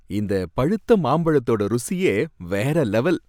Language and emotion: Tamil, happy